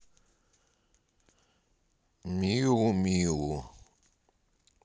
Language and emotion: Russian, neutral